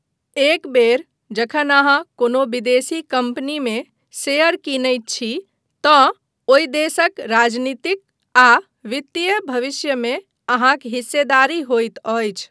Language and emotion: Maithili, neutral